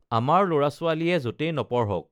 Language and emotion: Assamese, neutral